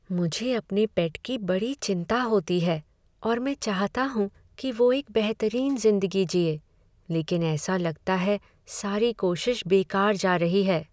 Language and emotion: Hindi, sad